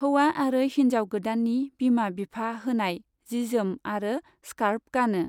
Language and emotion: Bodo, neutral